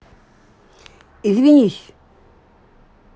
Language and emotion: Russian, angry